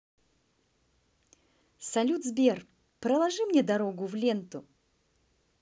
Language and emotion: Russian, positive